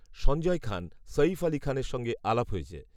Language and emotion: Bengali, neutral